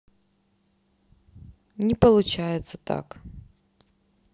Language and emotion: Russian, sad